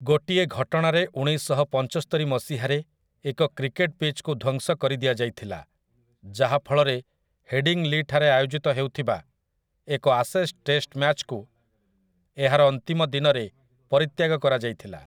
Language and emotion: Odia, neutral